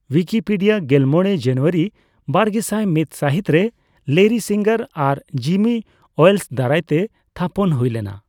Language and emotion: Santali, neutral